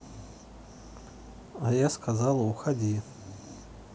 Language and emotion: Russian, neutral